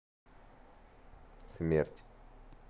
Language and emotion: Russian, neutral